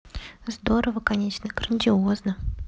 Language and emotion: Russian, neutral